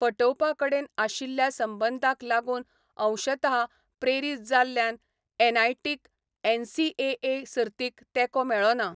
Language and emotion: Goan Konkani, neutral